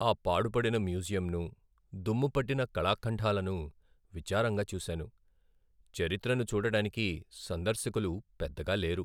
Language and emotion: Telugu, sad